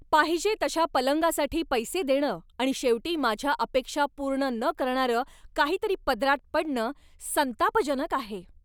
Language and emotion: Marathi, angry